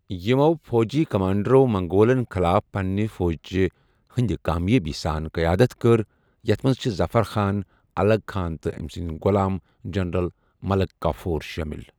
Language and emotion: Kashmiri, neutral